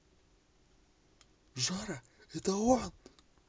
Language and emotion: Russian, neutral